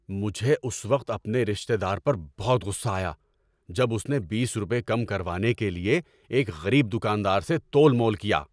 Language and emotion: Urdu, angry